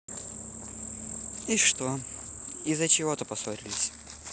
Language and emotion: Russian, neutral